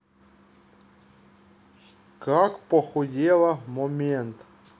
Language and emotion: Russian, neutral